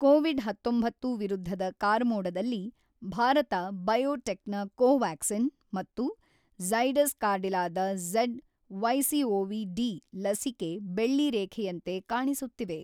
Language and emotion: Kannada, neutral